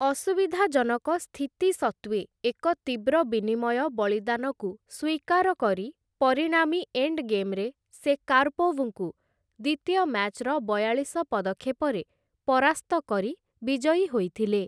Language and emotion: Odia, neutral